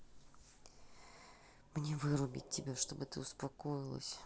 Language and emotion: Russian, angry